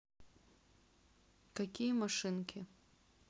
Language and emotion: Russian, neutral